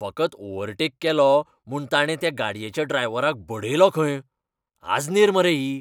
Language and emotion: Goan Konkani, angry